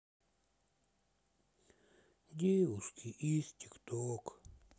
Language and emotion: Russian, sad